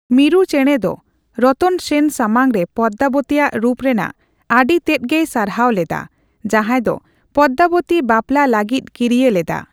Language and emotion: Santali, neutral